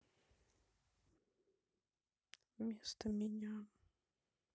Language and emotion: Russian, sad